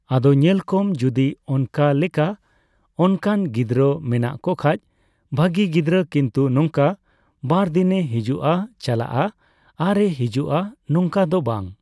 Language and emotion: Santali, neutral